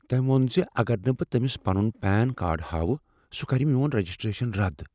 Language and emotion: Kashmiri, fearful